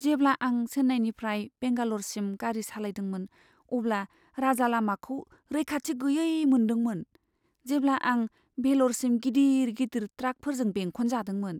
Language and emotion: Bodo, fearful